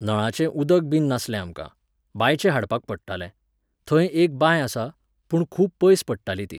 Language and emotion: Goan Konkani, neutral